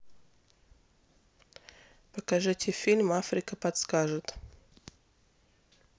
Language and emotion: Russian, neutral